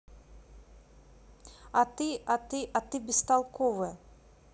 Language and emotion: Russian, neutral